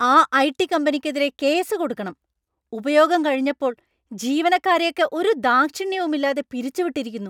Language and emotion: Malayalam, angry